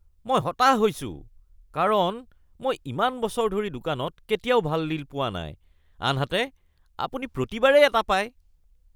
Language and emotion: Assamese, disgusted